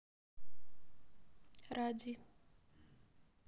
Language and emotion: Russian, neutral